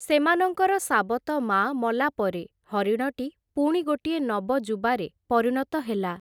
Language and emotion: Odia, neutral